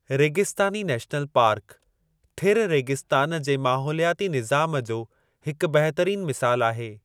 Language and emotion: Sindhi, neutral